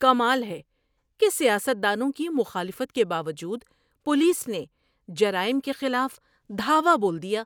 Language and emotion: Urdu, surprised